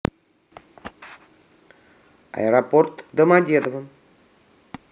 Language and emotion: Russian, neutral